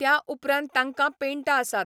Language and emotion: Goan Konkani, neutral